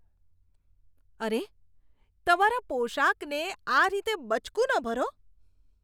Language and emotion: Gujarati, disgusted